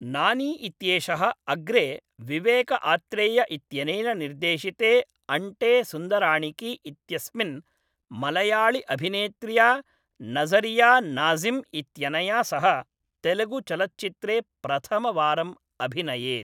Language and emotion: Sanskrit, neutral